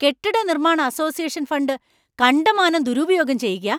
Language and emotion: Malayalam, angry